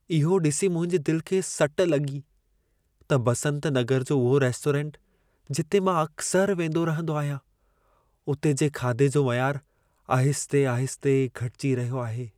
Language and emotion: Sindhi, sad